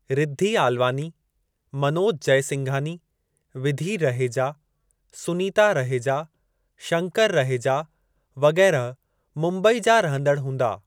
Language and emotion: Sindhi, neutral